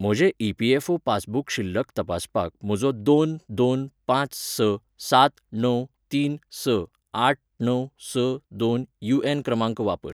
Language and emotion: Goan Konkani, neutral